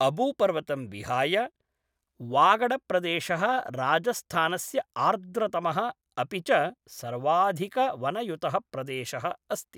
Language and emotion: Sanskrit, neutral